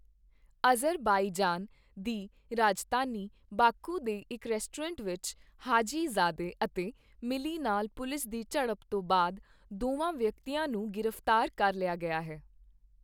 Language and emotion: Punjabi, neutral